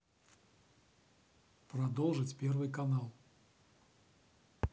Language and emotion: Russian, neutral